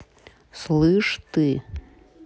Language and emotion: Russian, neutral